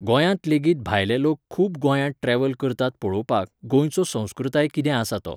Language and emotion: Goan Konkani, neutral